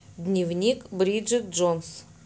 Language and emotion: Russian, neutral